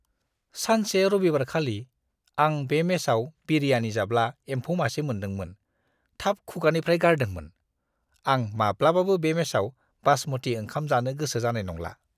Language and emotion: Bodo, disgusted